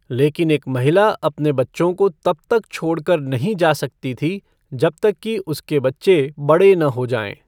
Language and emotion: Hindi, neutral